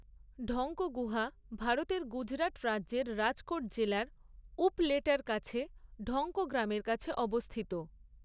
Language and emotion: Bengali, neutral